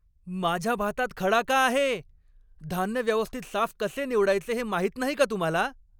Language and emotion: Marathi, angry